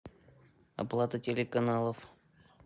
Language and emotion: Russian, neutral